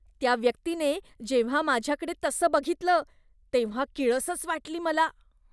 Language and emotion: Marathi, disgusted